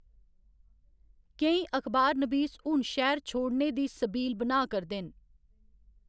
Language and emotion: Dogri, neutral